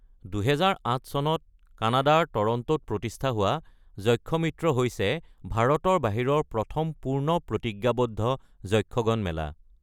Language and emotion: Assamese, neutral